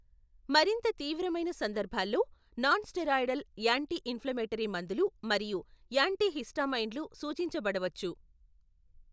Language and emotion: Telugu, neutral